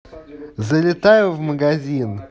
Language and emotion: Russian, positive